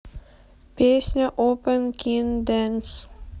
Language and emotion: Russian, neutral